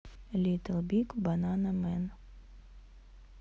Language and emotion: Russian, neutral